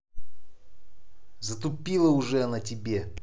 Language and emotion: Russian, angry